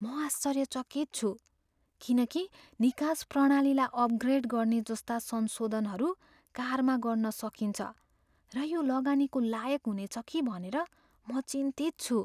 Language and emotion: Nepali, fearful